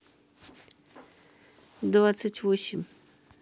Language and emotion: Russian, neutral